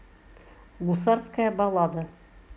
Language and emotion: Russian, neutral